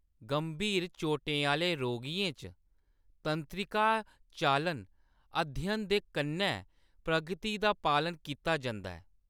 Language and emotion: Dogri, neutral